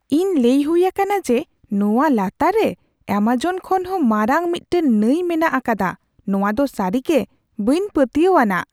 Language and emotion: Santali, surprised